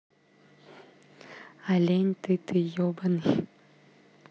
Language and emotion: Russian, neutral